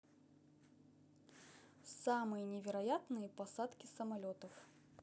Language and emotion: Russian, neutral